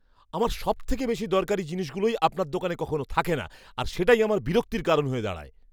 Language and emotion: Bengali, angry